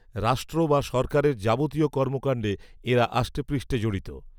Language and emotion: Bengali, neutral